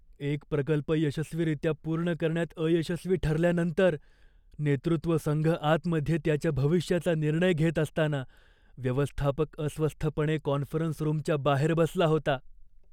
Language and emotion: Marathi, fearful